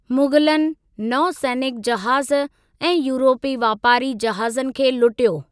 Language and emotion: Sindhi, neutral